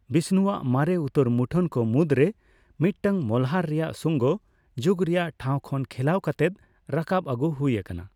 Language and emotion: Santali, neutral